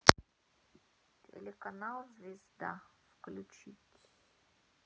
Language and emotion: Russian, sad